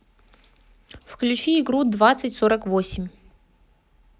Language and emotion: Russian, neutral